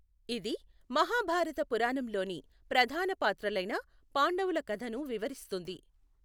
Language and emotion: Telugu, neutral